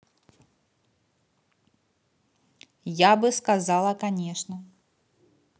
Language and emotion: Russian, neutral